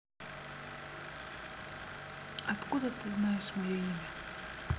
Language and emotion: Russian, neutral